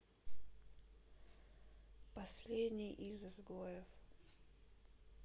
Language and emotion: Russian, sad